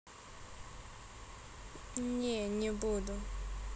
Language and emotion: Russian, neutral